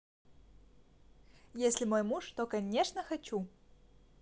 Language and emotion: Russian, positive